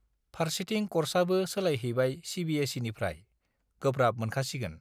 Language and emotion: Bodo, neutral